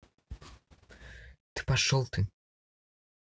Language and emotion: Russian, angry